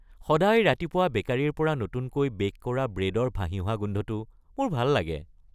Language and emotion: Assamese, happy